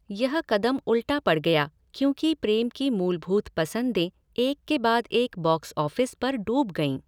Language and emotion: Hindi, neutral